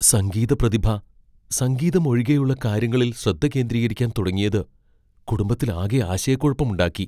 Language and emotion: Malayalam, fearful